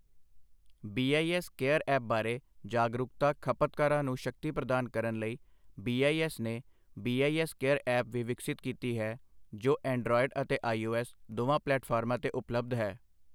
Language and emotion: Punjabi, neutral